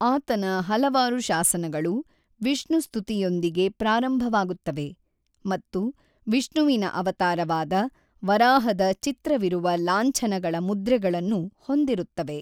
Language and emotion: Kannada, neutral